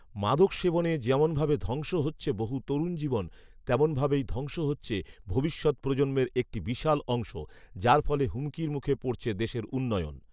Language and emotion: Bengali, neutral